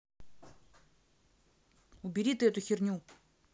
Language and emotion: Russian, angry